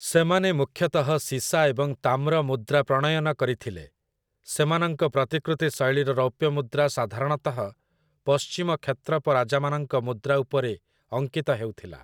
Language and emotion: Odia, neutral